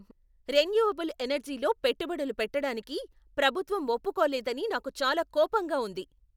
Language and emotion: Telugu, angry